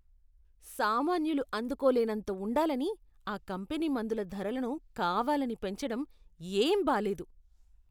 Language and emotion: Telugu, disgusted